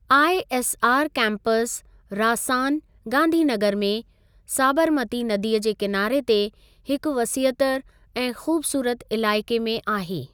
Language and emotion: Sindhi, neutral